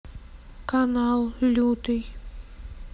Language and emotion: Russian, sad